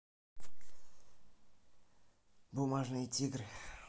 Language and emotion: Russian, neutral